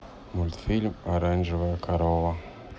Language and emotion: Russian, neutral